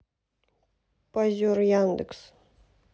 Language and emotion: Russian, neutral